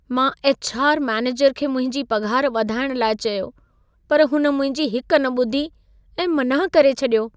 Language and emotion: Sindhi, sad